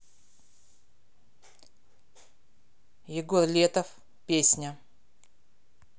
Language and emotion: Russian, neutral